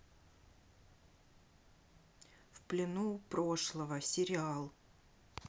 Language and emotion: Russian, sad